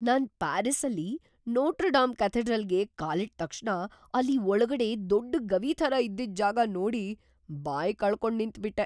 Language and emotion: Kannada, surprised